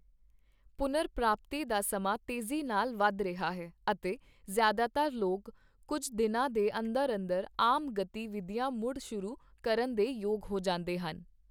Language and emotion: Punjabi, neutral